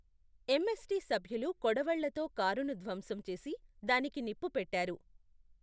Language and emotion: Telugu, neutral